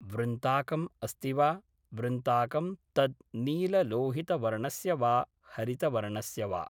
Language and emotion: Sanskrit, neutral